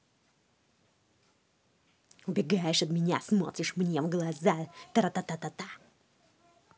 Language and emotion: Russian, angry